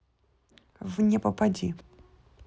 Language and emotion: Russian, neutral